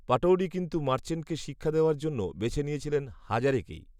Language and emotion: Bengali, neutral